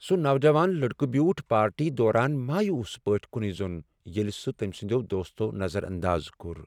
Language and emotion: Kashmiri, sad